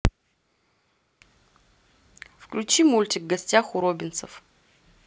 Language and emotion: Russian, neutral